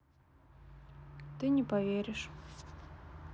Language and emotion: Russian, sad